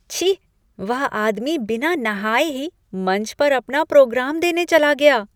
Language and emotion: Hindi, disgusted